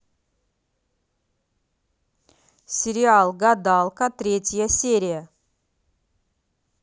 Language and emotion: Russian, neutral